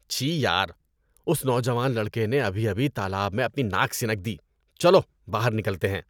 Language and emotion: Urdu, disgusted